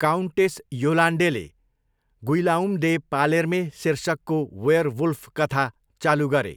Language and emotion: Nepali, neutral